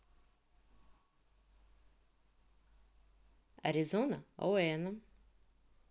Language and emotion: Russian, neutral